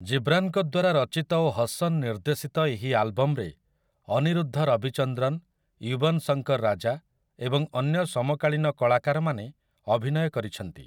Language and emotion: Odia, neutral